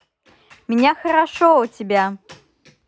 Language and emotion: Russian, positive